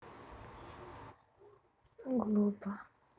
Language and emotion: Russian, sad